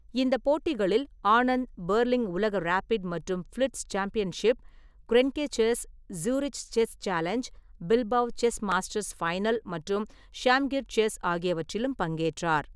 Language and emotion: Tamil, neutral